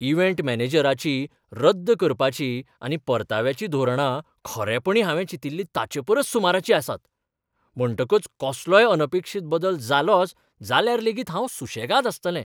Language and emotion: Goan Konkani, surprised